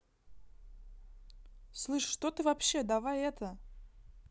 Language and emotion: Russian, angry